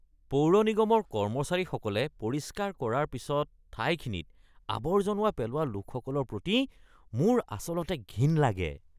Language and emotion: Assamese, disgusted